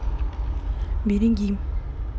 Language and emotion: Russian, neutral